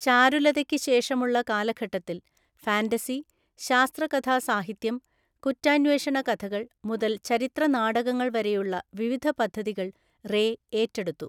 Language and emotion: Malayalam, neutral